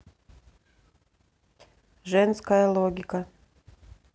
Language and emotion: Russian, neutral